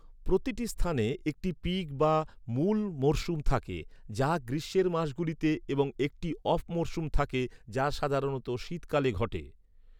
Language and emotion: Bengali, neutral